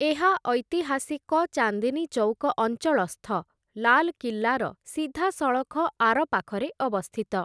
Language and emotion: Odia, neutral